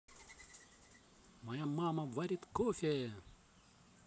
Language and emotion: Russian, positive